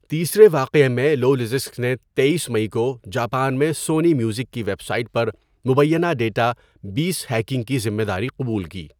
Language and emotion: Urdu, neutral